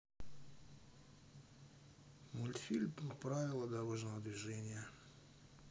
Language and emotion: Russian, sad